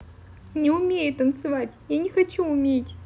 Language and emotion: Russian, sad